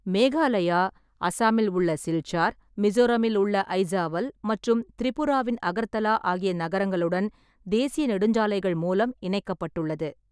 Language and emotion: Tamil, neutral